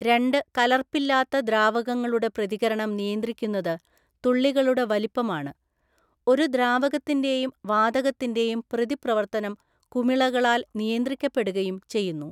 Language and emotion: Malayalam, neutral